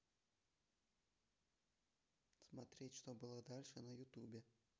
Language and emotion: Russian, neutral